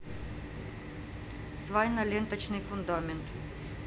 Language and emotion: Russian, neutral